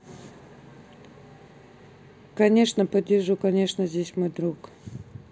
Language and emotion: Russian, neutral